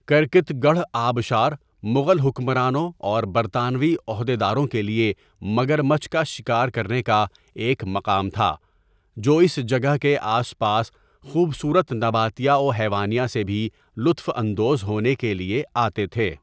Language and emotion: Urdu, neutral